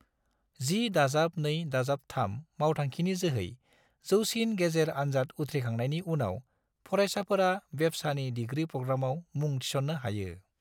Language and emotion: Bodo, neutral